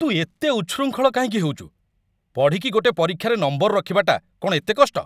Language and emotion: Odia, angry